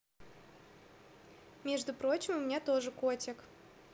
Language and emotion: Russian, positive